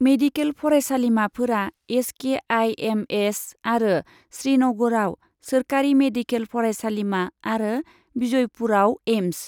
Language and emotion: Bodo, neutral